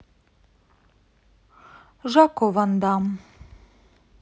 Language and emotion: Russian, sad